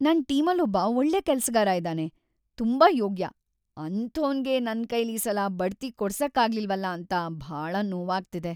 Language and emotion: Kannada, sad